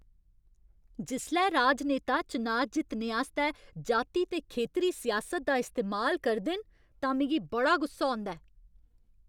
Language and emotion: Dogri, angry